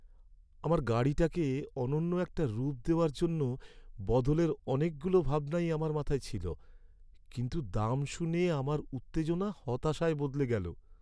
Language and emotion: Bengali, sad